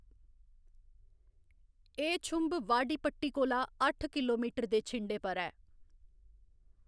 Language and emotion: Dogri, neutral